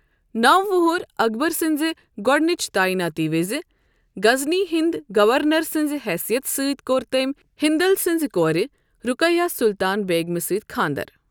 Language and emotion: Kashmiri, neutral